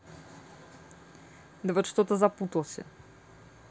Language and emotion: Russian, neutral